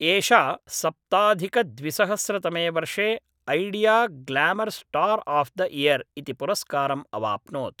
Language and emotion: Sanskrit, neutral